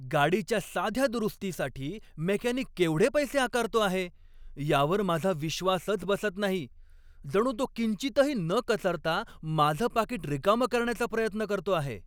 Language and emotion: Marathi, angry